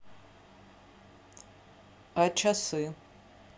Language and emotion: Russian, neutral